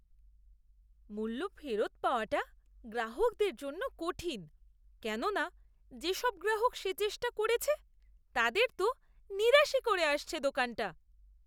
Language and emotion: Bengali, disgusted